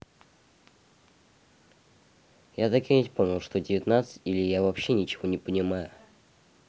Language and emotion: Russian, neutral